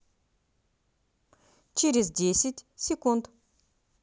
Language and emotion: Russian, positive